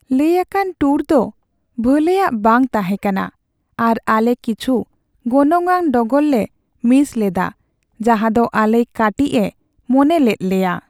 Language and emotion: Santali, sad